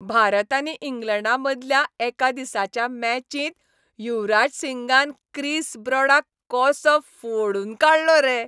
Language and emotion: Goan Konkani, happy